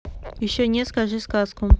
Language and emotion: Russian, neutral